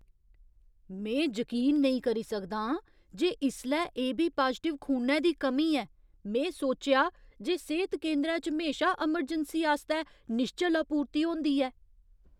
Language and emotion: Dogri, surprised